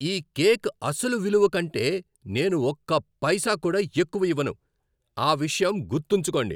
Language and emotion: Telugu, angry